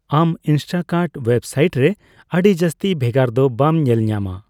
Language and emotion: Santali, neutral